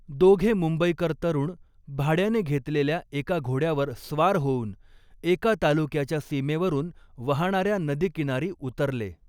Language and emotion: Marathi, neutral